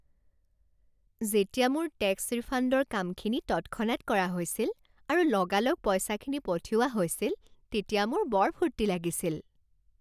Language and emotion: Assamese, happy